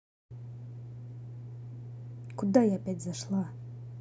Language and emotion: Russian, angry